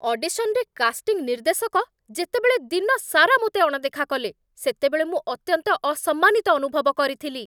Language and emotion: Odia, angry